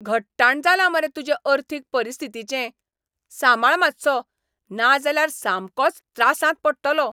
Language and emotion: Goan Konkani, angry